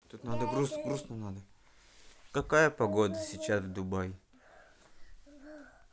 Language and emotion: Russian, neutral